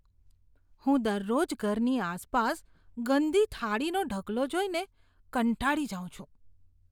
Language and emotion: Gujarati, disgusted